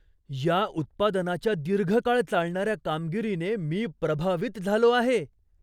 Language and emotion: Marathi, surprised